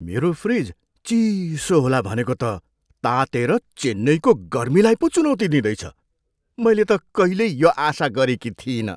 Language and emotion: Nepali, surprised